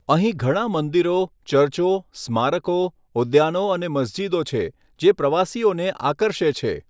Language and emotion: Gujarati, neutral